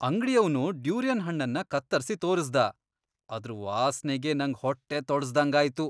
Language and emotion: Kannada, disgusted